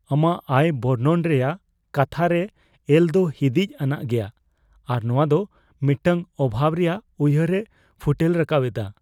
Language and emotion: Santali, fearful